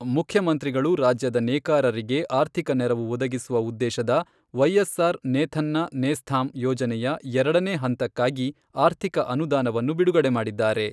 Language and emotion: Kannada, neutral